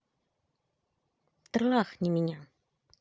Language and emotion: Russian, positive